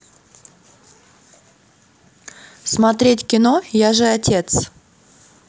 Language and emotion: Russian, neutral